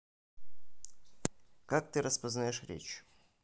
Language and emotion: Russian, neutral